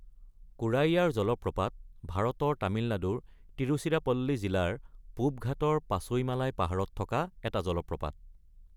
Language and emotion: Assamese, neutral